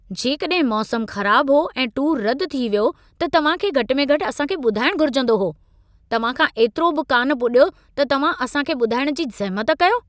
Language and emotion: Sindhi, angry